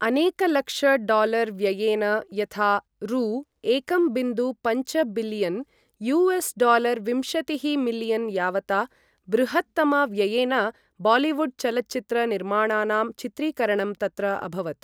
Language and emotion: Sanskrit, neutral